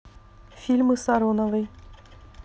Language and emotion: Russian, neutral